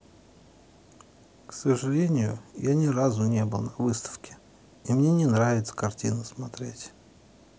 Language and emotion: Russian, sad